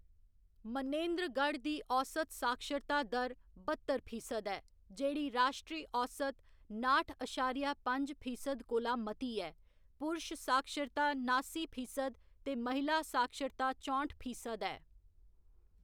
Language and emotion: Dogri, neutral